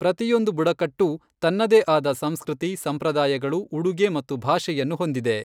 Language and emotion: Kannada, neutral